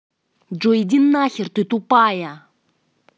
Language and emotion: Russian, angry